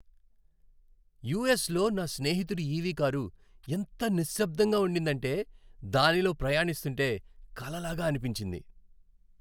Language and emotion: Telugu, happy